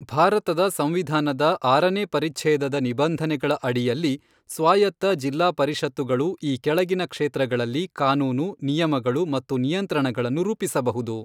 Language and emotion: Kannada, neutral